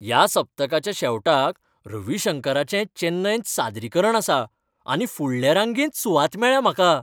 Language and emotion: Goan Konkani, happy